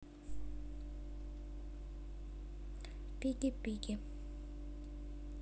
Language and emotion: Russian, neutral